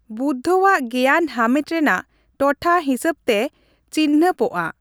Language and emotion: Santali, neutral